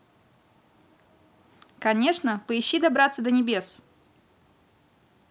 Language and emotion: Russian, positive